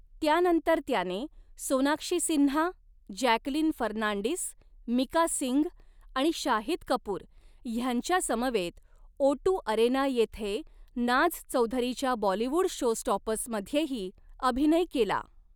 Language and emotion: Marathi, neutral